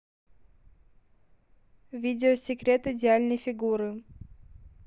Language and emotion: Russian, neutral